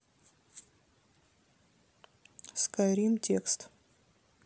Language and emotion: Russian, neutral